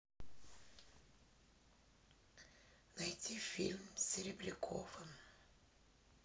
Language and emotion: Russian, sad